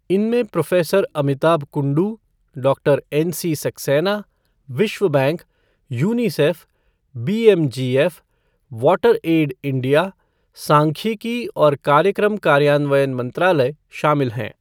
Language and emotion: Hindi, neutral